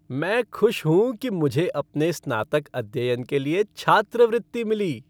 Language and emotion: Hindi, happy